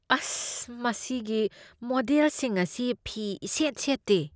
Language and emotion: Manipuri, disgusted